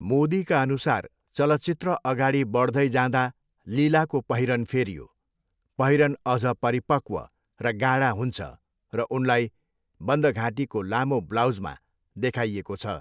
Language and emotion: Nepali, neutral